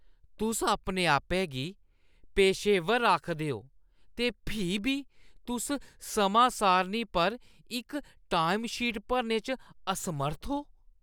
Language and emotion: Dogri, disgusted